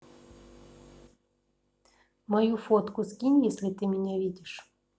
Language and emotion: Russian, neutral